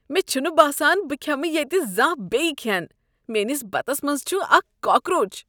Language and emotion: Kashmiri, disgusted